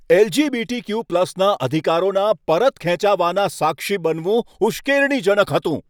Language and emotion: Gujarati, angry